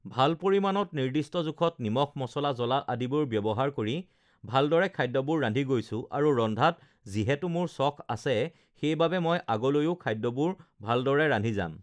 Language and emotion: Assamese, neutral